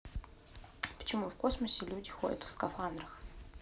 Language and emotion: Russian, neutral